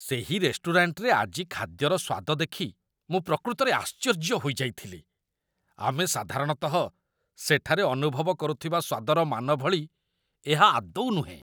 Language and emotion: Odia, disgusted